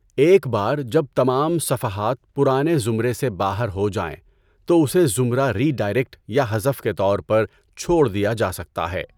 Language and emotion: Urdu, neutral